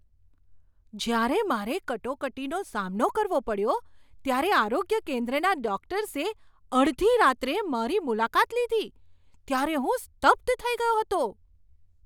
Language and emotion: Gujarati, surprised